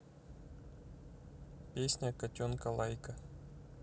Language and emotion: Russian, neutral